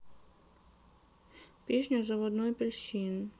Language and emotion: Russian, sad